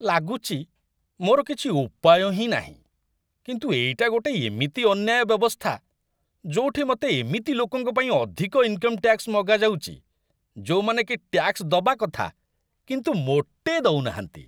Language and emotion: Odia, disgusted